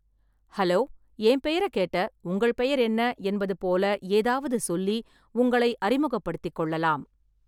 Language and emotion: Tamil, neutral